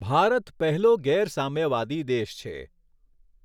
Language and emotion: Gujarati, neutral